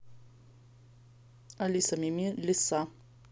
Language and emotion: Russian, neutral